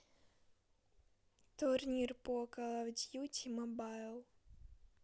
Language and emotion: Russian, neutral